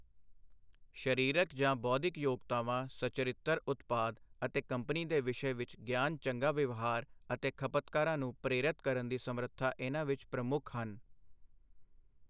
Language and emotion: Punjabi, neutral